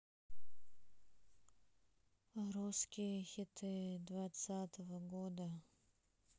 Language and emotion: Russian, sad